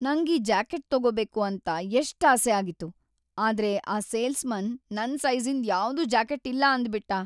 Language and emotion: Kannada, sad